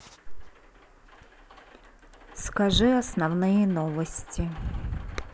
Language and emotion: Russian, neutral